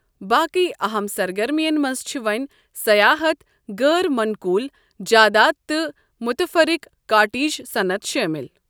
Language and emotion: Kashmiri, neutral